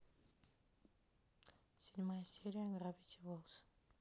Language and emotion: Russian, neutral